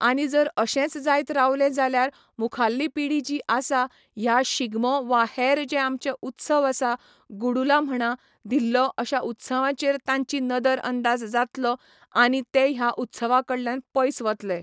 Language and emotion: Goan Konkani, neutral